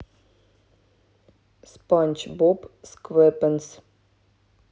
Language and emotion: Russian, neutral